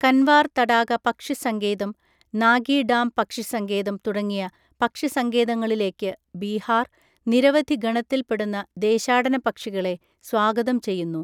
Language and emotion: Malayalam, neutral